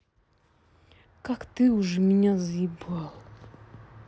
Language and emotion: Russian, angry